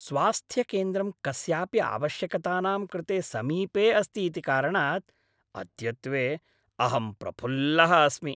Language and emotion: Sanskrit, happy